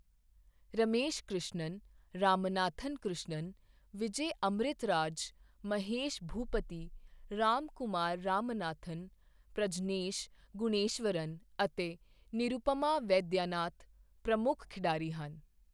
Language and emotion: Punjabi, neutral